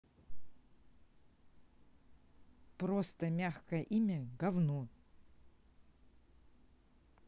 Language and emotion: Russian, neutral